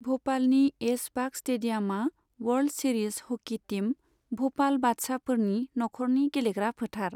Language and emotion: Bodo, neutral